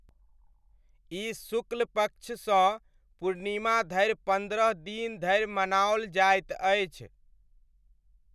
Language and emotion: Maithili, neutral